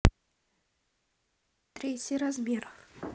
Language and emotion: Russian, neutral